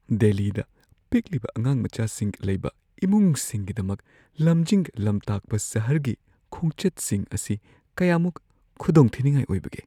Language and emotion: Manipuri, fearful